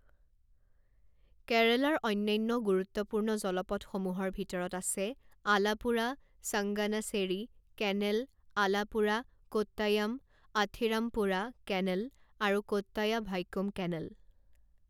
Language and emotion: Assamese, neutral